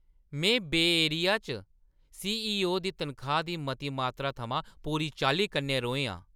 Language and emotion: Dogri, angry